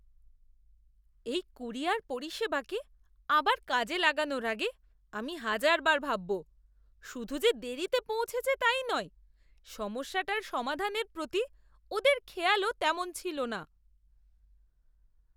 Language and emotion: Bengali, disgusted